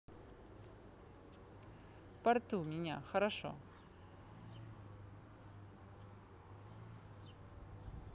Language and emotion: Russian, neutral